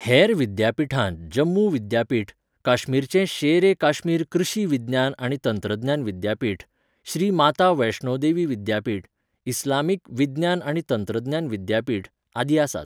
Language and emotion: Goan Konkani, neutral